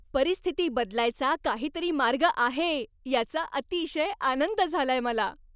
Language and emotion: Marathi, happy